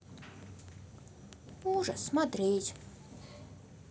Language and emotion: Russian, neutral